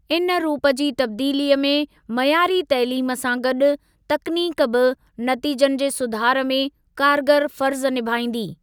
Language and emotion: Sindhi, neutral